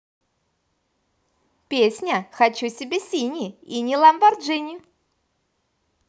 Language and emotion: Russian, positive